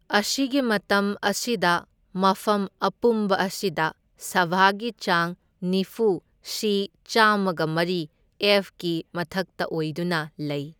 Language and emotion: Manipuri, neutral